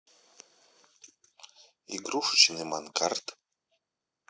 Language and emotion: Russian, neutral